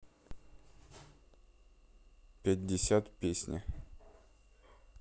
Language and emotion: Russian, neutral